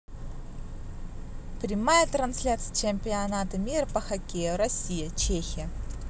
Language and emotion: Russian, positive